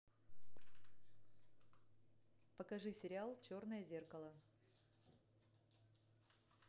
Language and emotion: Russian, neutral